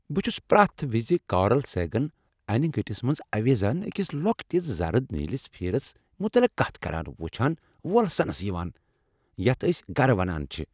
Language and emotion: Kashmiri, happy